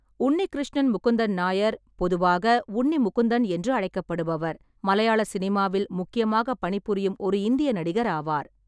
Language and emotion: Tamil, neutral